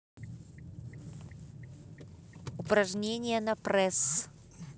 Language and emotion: Russian, neutral